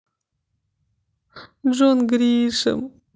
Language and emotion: Russian, sad